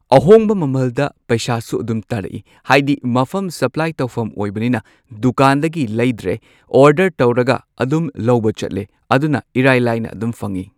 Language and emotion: Manipuri, neutral